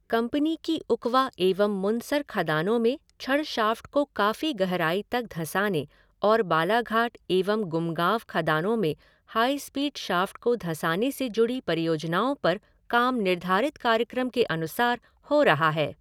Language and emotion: Hindi, neutral